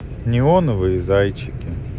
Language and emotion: Russian, neutral